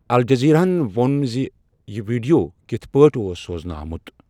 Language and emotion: Kashmiri, neutral